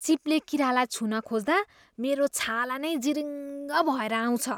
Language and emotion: Nepali, disgusted